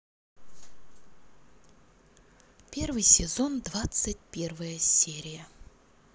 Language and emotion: Russian, neutral